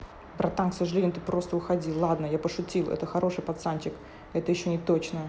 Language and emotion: Russian, neutral